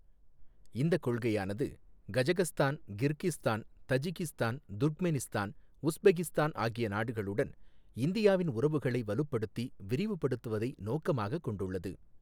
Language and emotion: Tamil, neutral